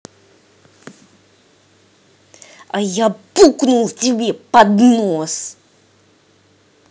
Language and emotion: Russian, angry